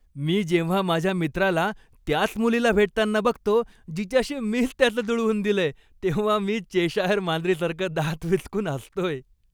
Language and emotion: Marathi, happy